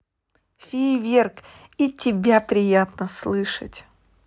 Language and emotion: Russian, positive